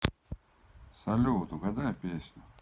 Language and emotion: Russian, neutral